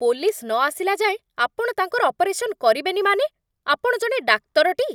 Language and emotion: Odia, angry